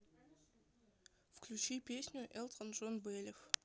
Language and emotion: Russian, neutral